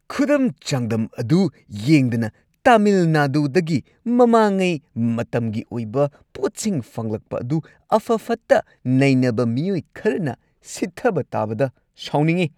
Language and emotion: Manipuri, angry